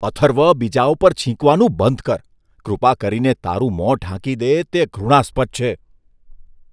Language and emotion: Gujarati, disgusted